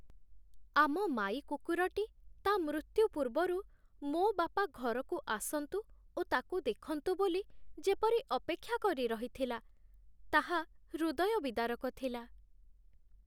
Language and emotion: Odia, sad